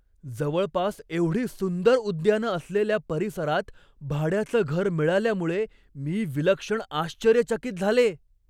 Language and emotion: Marathi, surprised